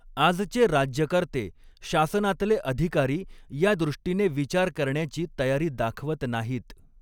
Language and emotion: Marathi, neutral